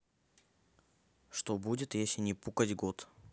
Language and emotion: Russian, neutral